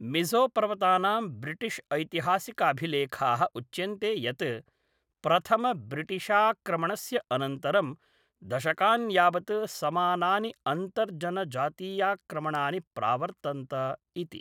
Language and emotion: Sanskrit, neutral